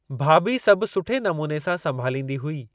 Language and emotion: Sindhi, neutral